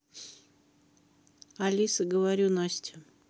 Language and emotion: Russian, neutral